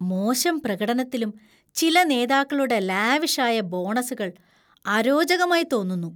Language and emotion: Malayalam, disgusted